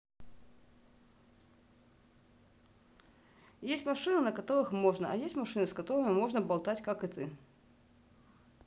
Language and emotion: Russian, neutral